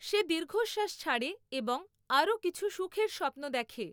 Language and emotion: Bengali, neutral